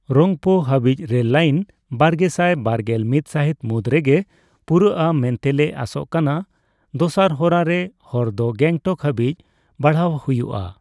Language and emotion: Santali, neutral